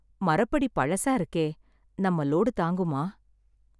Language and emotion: Tamil, sad